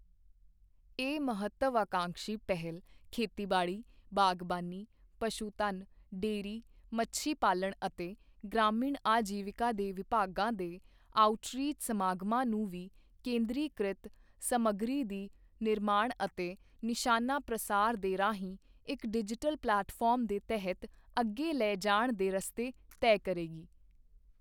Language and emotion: Punjabi, neutral